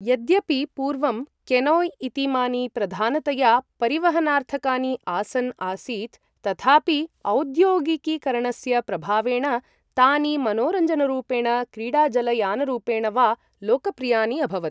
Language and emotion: Sanskrit, neutral